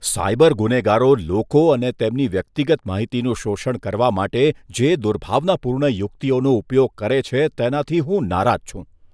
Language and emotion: Gujarati, disgusted